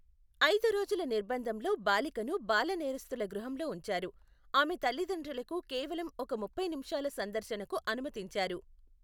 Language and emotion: Telugu, neutral